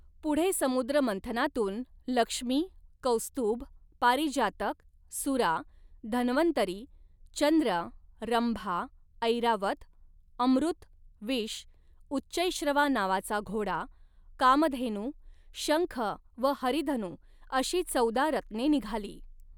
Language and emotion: Marathi, neutral